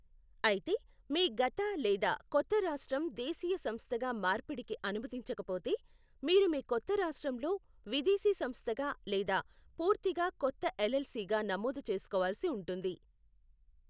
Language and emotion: Telugu, neutral